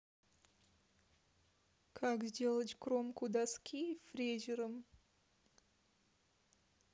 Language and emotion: Russian, sad